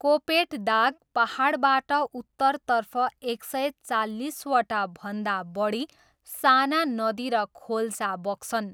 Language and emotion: Nepali, neutral